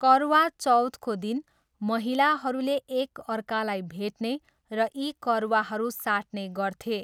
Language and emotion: Nepali, neutral